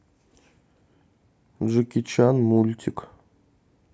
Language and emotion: Russian, neutral